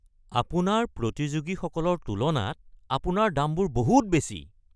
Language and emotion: Assamese, angry